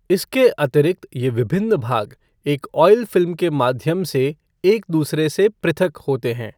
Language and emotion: Hindi, neutral